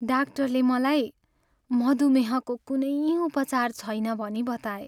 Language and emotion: Nepali, sad